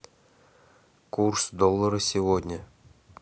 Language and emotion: Russian, neutral